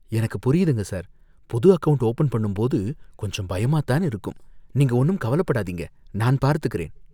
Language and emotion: Tamil, fearful